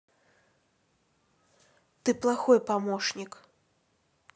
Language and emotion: Russian, neutral